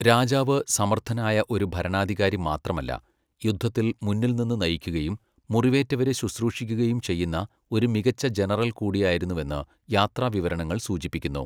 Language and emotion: Malayalam, neutral